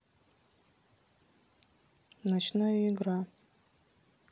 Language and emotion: Russian, neutral